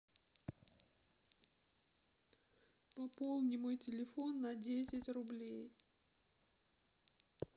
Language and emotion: Russian, sad